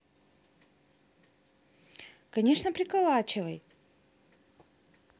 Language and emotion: Russian, positive